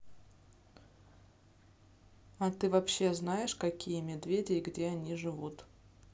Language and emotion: Russian, neutral